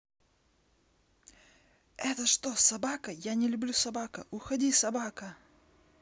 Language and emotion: Russian, angry